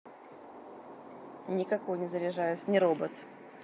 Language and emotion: Russian, neutral